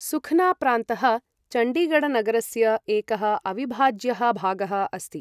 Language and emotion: Sanskrit, neutral